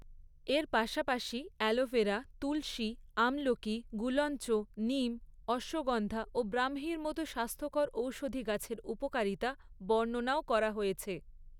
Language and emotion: Bengali, neutral